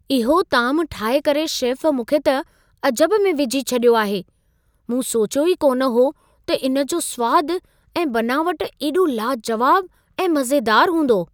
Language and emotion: Sindhi, surprised